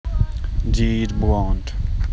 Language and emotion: Russian, neutral